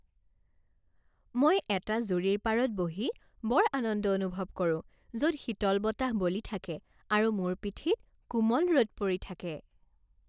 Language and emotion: Assamese, happy